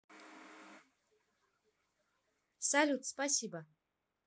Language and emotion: Russian, neutral